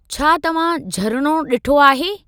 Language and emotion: Sindhi, neutral